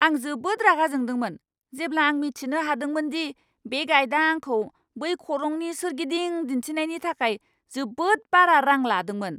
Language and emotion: Bodo, angry